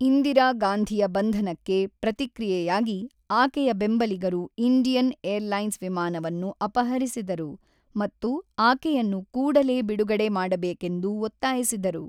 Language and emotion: Kannada, neutral